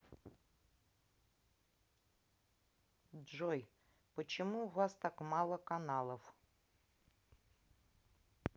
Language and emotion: Russian, neutral